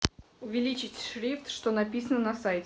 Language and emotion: Russian, neutral